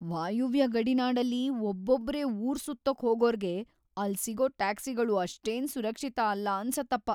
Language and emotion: Kannada, fearful